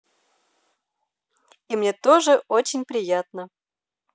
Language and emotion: Russian, positive